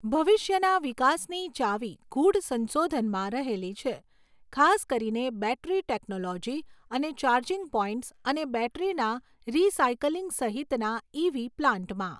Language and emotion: Gujarati, neutral